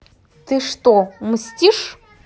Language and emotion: Russian, neutral